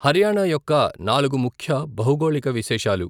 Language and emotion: Telugu, neutral